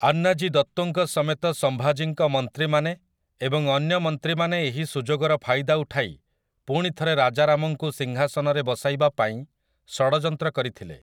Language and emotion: Odia, neutral